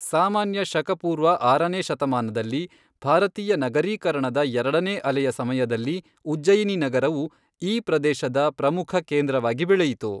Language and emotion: Kannada, neutral